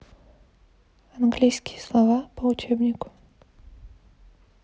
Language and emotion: Russian, neutral